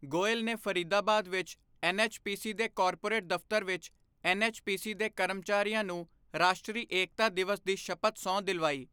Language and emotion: Punjabi, neutral